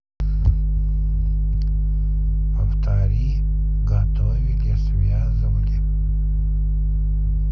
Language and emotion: Russian, neutral